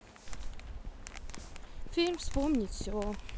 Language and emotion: Russian, neutral